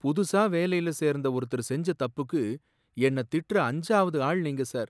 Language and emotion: Tamil, sad